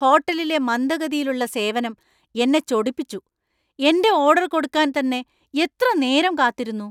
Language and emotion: Malayalam, angry